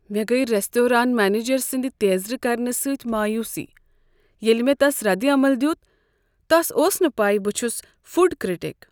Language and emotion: Kashmiri, sad